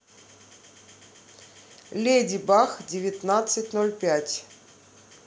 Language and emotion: Russian, neutral